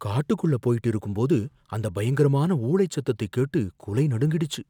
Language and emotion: Tamil, fearful